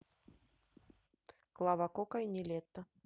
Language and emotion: Russian, neutral